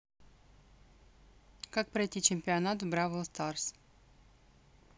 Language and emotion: Russian, neutral